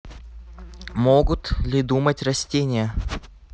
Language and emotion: Russian, neutral